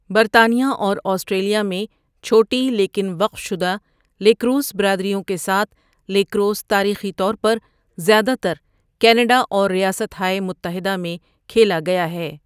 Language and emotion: Urdu, neutral